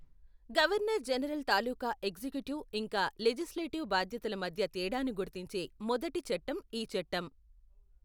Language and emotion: Telugu, neutral